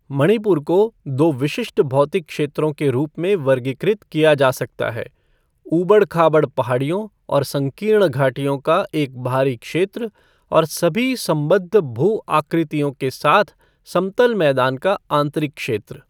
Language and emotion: Hindi, neutral